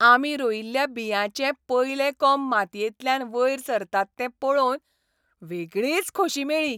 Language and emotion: Goan Konkani, happy